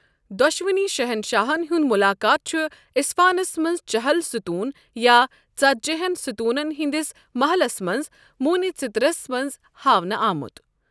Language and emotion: Kashmiri, neutral